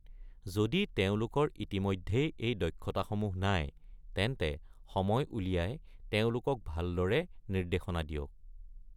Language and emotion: Assamese, neutral